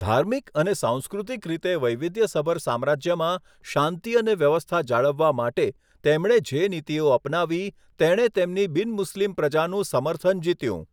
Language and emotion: Gujarati, neutral